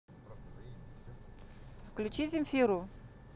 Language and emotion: Russian, neutral